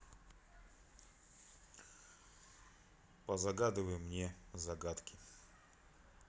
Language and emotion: Russian, neutral